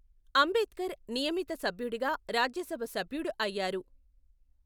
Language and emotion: Telugu, neutral